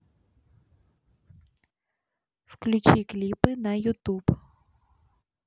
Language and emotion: Russian, neutral